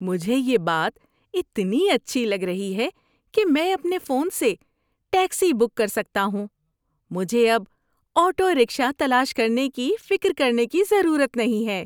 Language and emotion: Urdu, happy